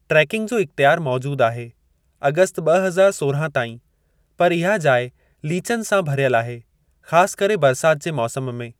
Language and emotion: Sindhi, neutral